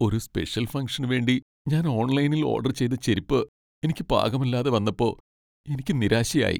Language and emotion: Malayalam, sad